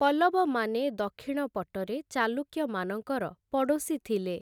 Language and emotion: Odia, neutral